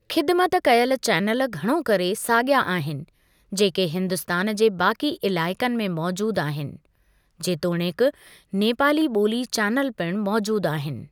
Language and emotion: Sindhi, neutral